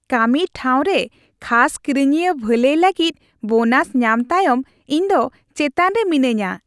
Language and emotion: Santali, happy